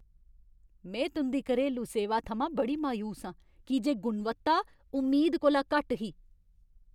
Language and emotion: Dogri, angry